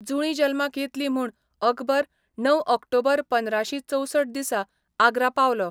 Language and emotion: Goan Konkani, neutral